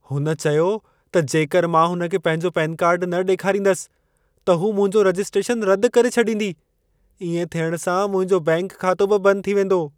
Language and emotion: Sindhi, fearful